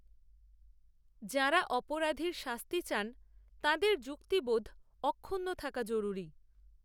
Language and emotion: Bengali, neutral